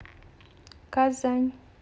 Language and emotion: Russian, neutral